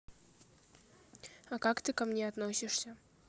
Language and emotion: Russian, neutral